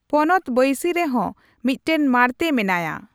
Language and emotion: Santali, neutral